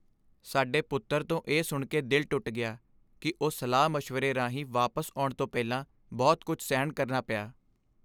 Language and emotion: Punjabi, sad